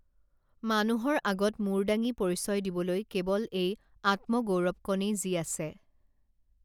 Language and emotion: Assamese, neutral